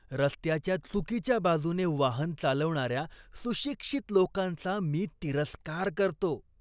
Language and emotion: Marathi, disgusted